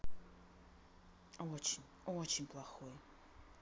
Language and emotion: Russian, sad